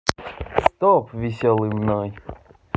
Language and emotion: Russian, positive